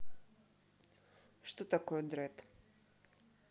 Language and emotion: Russian, neutral